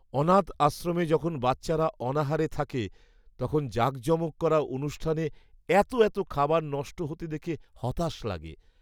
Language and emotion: Bengali, sad